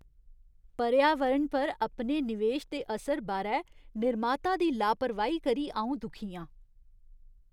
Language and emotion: Dogri, disgusted